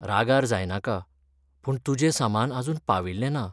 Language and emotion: Goan Konkani, sad